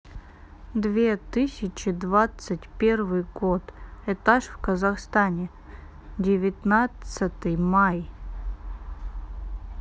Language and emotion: Russian, neutral